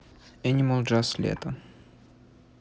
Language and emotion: Russian, neutral